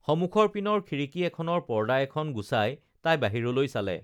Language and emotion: Assamese, neutral